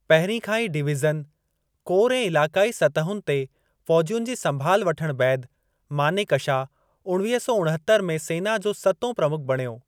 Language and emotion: Sindhi, neutral